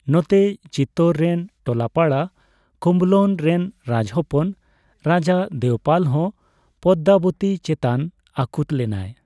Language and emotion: Santali, neutral